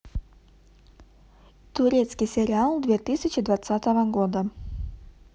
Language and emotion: Russian, neutral